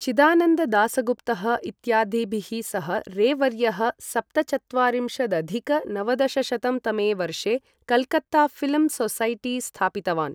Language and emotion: Sanskrit, neutral